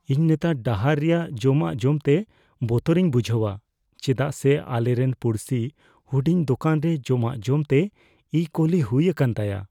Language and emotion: Santali, fearful